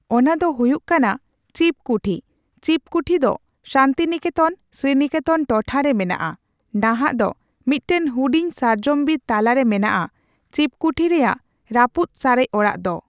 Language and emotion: Santali, neutral